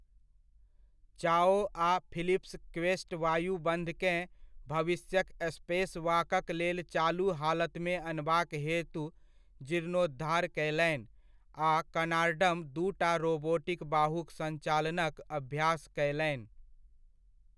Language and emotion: Maithili, neutral